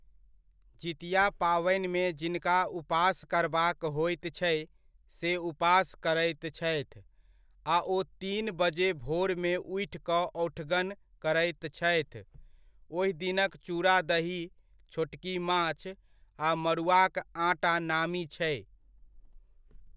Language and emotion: Maithili, neutral